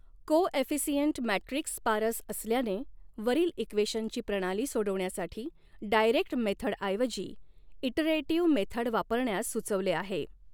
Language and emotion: Marathi, neutral